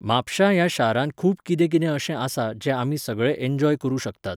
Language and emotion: Goan Konkani, neutral